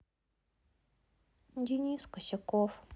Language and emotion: Russian, sad